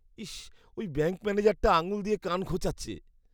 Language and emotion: Bengali, disgusted